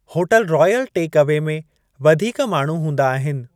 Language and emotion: Sindhi, neutral